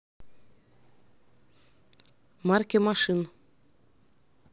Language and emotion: Russian, neutral